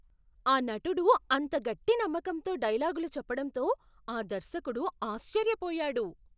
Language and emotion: Telugu, surprised